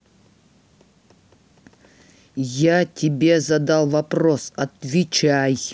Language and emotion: Russian, angry